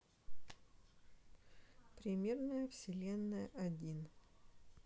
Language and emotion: Russian, neutral